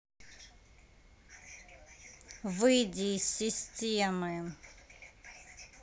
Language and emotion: Russian, angry